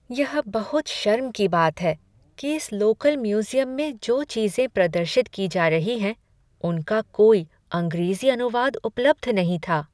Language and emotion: Hindi, sad